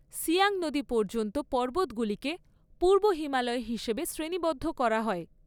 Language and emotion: Bengali, neutral